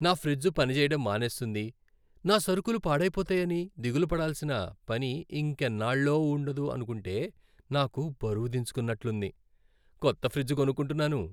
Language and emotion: Telugu, happy